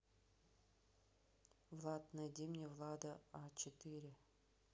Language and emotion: Russian, neutral